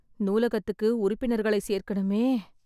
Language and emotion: Tamil, sad